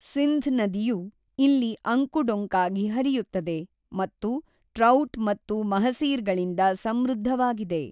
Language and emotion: Kannada, neutral